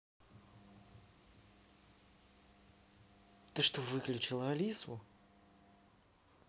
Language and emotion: Russian, angry